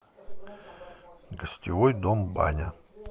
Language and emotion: Russian, neutral